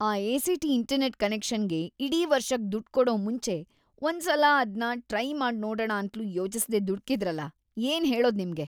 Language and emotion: Kannada, disgusted